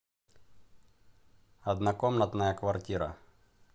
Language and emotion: Russian, neutral